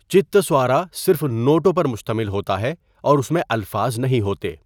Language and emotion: Urdu, neutral